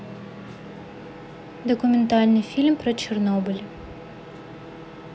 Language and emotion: Russian, neutral